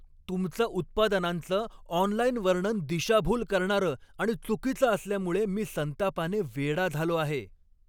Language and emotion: Marathi, angry